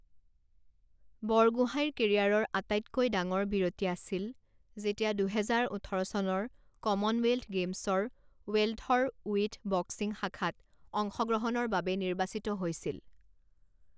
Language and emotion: Assamese, neutral